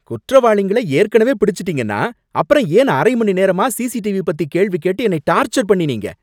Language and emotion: Tamil, angry